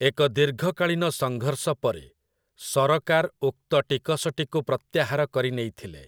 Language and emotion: Odia, neutral